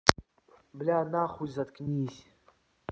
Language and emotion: Russian, angry